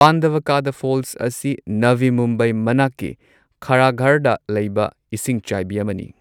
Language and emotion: Manipuri, neutral